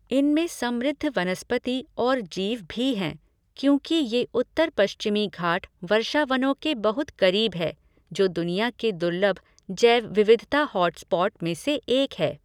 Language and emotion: Hindi, neutral